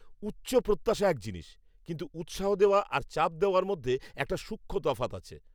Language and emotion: Bengali, angry